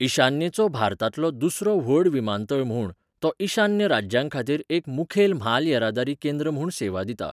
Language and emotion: Goan Konkani, neutral